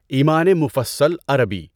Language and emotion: Urdu, neutral